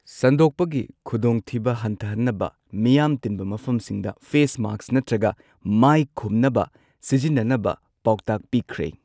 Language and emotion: Manipuri, neutral